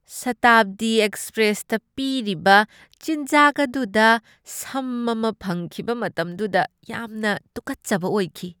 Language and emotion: Manipuri, disgusted